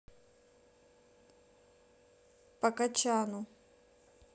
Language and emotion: Russian, neutral